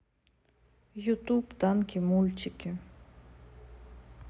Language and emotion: Russian, neutral